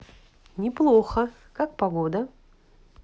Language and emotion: Russian, positive